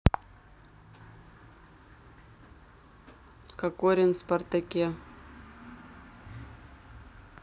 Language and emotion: Russian, neutral